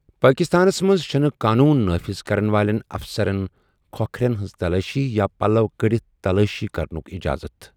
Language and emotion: Kashmiri, neutral